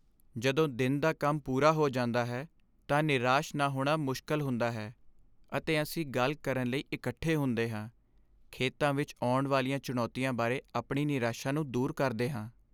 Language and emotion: Punjabi, sad